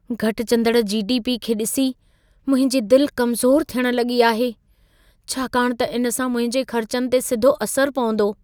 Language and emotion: Sindhi, fearful